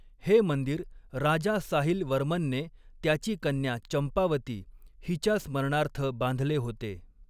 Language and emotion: Marathi, neutral